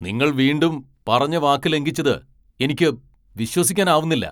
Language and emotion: Malayalam, angry